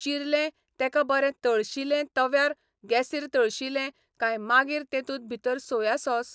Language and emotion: Goan Konkani, neutral